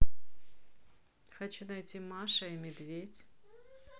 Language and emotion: Russian, neutral